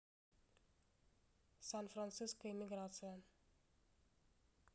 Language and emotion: Russian, neutral